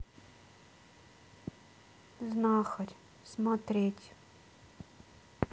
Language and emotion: Russian, sad